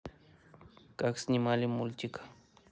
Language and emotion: Russian, neutral